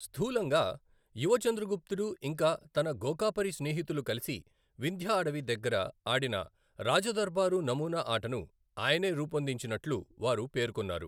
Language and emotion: Telugu, neutral